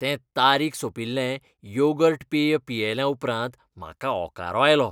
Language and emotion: Goan Konkani, disgusted